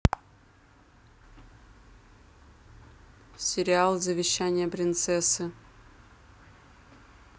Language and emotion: Russian, neutral